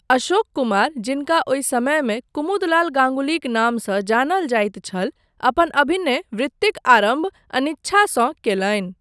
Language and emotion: Maithili, neutral